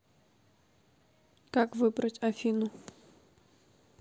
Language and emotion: Russian, neutral